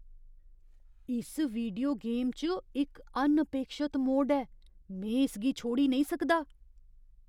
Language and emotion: Dogri, surprised